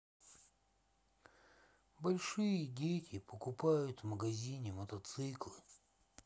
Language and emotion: Russian, sad